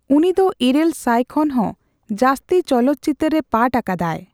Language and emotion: Santali, neutral